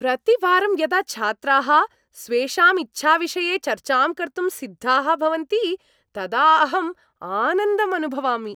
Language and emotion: Sanskrit, happy